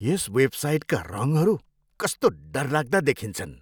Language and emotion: Nepali, disgusted